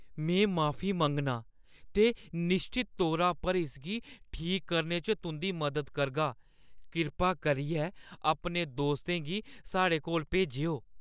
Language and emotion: Dogri, fearful